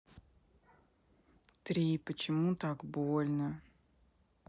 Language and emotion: Russian, sad